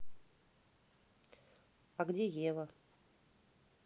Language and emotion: Russian, neutral